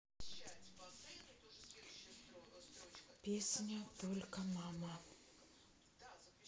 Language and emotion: Russian, neutral